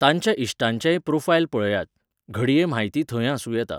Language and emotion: Goan Konkani, neutral